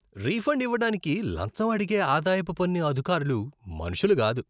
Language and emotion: Telugu, disgusted